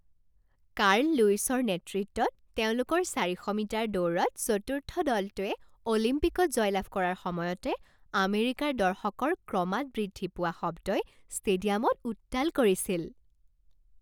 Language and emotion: Assamese, happy